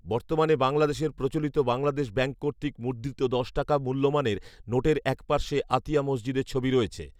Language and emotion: Bengali, neutral